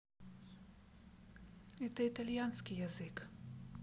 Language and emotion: Russian, sad